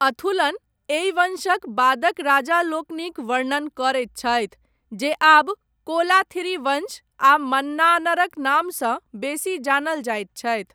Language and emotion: Maithili, neutral